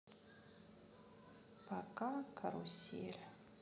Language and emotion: Russian, sad